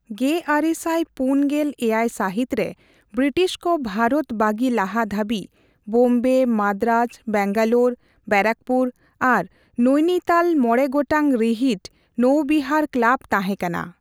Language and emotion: Santali, neutral